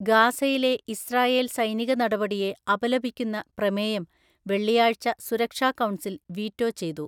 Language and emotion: Malayalam, neutral